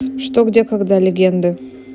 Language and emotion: Russian, neutral